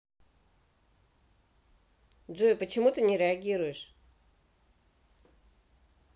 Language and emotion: Russian, neutral